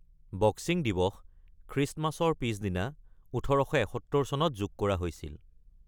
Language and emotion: Assamese, neutral